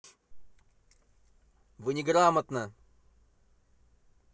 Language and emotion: Russian, angry